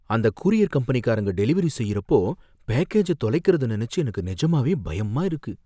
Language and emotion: Tamil, fearful